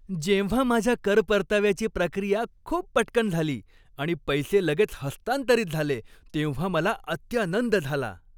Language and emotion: Marathi, happy